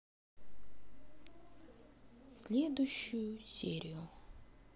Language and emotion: Russian, neutral